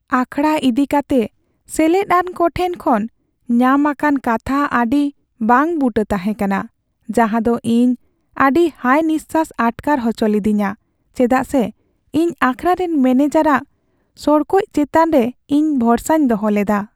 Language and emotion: Santali, sad